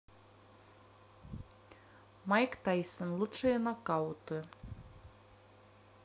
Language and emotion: Russian, neutral